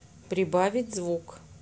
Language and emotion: Russian, neutral